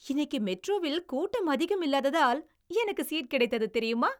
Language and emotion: Tamil, happy